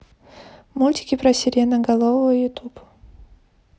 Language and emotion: Russian, neutral